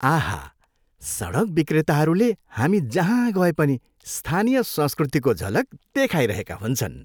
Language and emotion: Nepali, happy